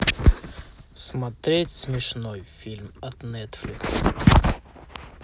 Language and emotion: Russian, neutral